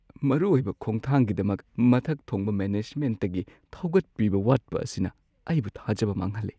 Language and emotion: Manipuri, sad